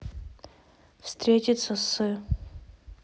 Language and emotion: Russian, neutral